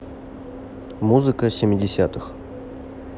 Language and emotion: Russian, neutral